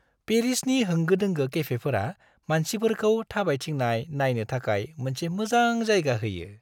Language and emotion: Bodo, happy